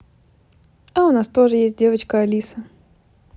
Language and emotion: Russian, positive